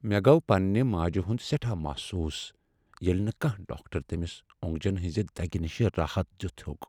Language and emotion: Kashmiri, sad